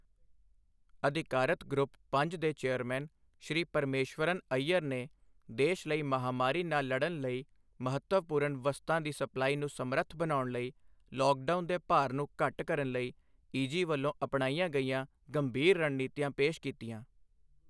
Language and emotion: Punjabi, neutral